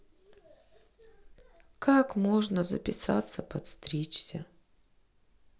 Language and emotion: Russian, sad